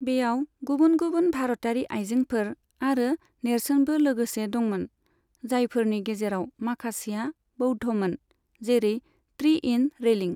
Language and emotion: Bodo, neutral